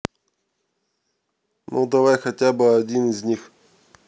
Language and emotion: Russian, neutral